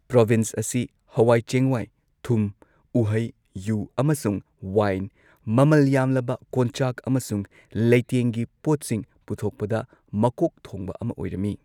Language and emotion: Manipuri, neutral